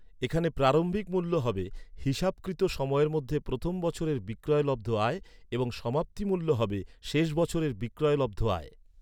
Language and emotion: Bengali, neutral